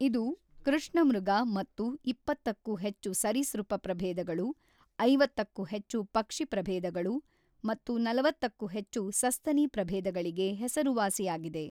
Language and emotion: Kannada, neutral